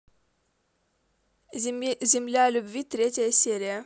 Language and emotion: Russian, neutral